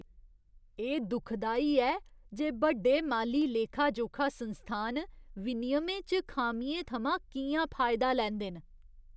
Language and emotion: Dogri, disgusted